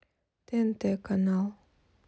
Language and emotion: Russian, neutral